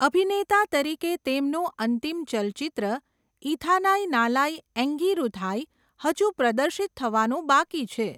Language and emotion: Gujarati, neutral